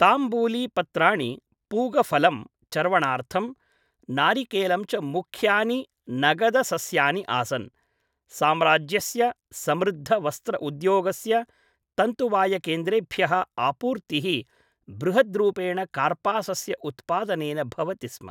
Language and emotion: Sanskrit, neutral